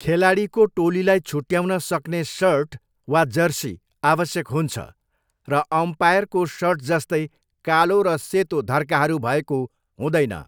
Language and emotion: Nepali, neutral